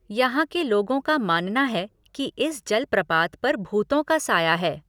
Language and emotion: Hindi, neutral